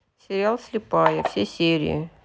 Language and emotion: Russian, neutral